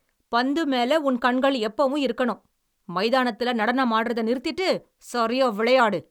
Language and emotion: Tamil, angry